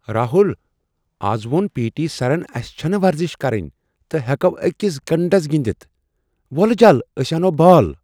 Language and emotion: Kashmiri, surprised